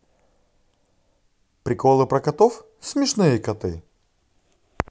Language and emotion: Russian, positive